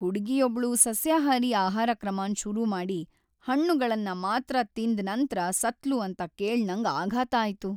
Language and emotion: Kannada, sad